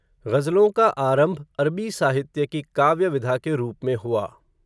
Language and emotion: Hindi, neutral